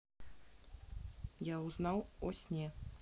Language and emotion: Russian, neutral